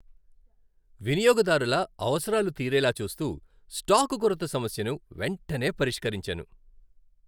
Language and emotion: Telugu, happy